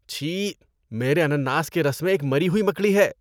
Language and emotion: Urdu, disgusted